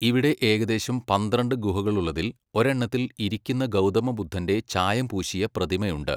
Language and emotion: Malayalam, neutral